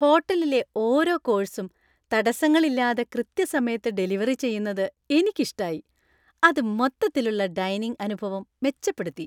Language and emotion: Malayalam, happy